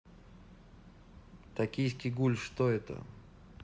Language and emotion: Russian, neutral